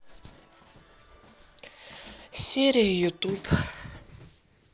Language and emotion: Russian, sad